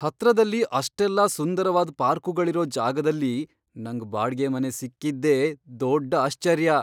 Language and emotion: Kannada, surprised